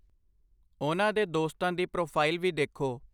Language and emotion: Punjabi, neutral